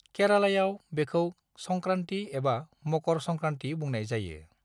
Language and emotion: Bodo, neutral